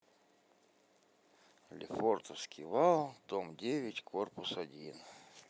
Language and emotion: Russian, neutral